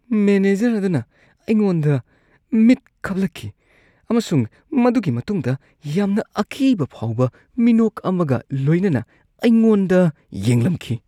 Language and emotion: Manipuri, disgusted